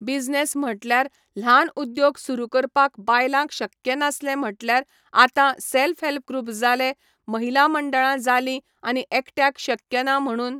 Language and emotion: Goan Konkani, neutral